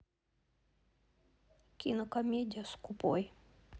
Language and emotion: Russian, sad